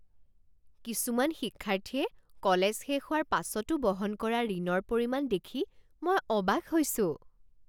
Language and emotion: Assamese, surprised